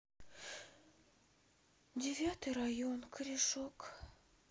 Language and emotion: Russian, sad